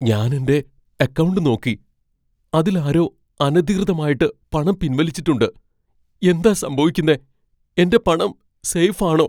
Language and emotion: Malayalam, fearful